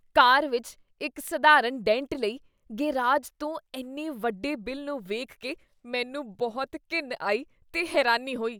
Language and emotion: Punjabi, disgusted